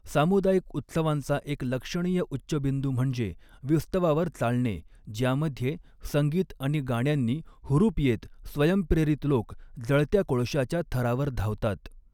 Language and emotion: Marathi, neutral